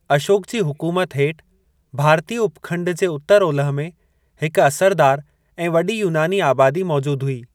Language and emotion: Sindhi, neutral